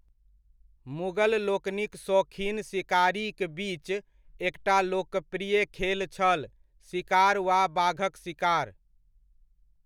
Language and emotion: Maithili, neutral